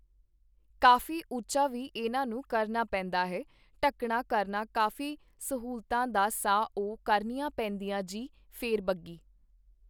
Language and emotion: Punjabi, neutral